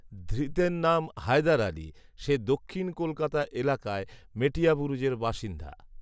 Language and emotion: Bengali, neutral